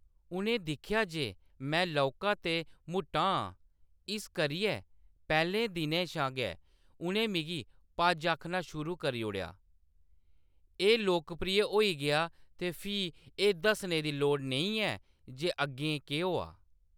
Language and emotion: Dogri, neutral